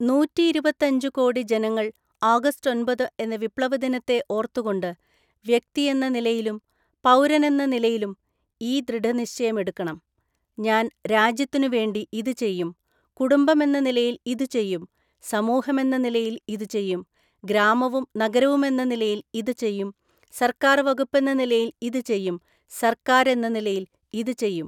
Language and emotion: Malayalam, neutral